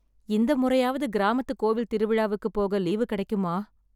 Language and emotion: Tamil, sad